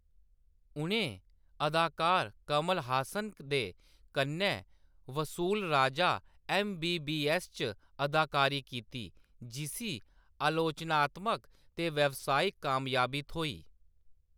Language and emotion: Dogri, neutral